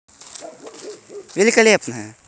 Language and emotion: Russian, positive